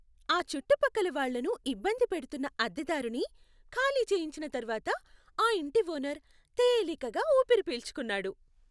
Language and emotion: Telugu, happy